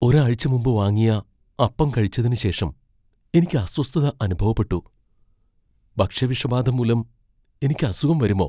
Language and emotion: Malayalam, fearful